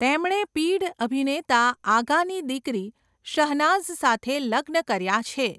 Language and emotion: Gujarati, neutral